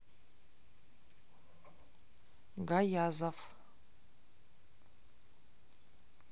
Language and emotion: Russian, neutral